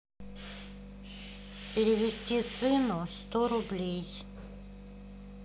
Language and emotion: Russian, neutral